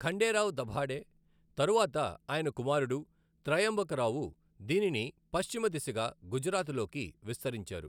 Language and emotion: Telugu, neutral